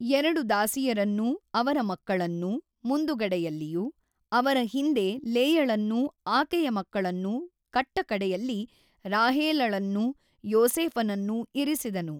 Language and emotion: Kannada, neutral